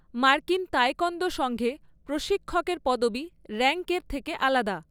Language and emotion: Bengali, neutral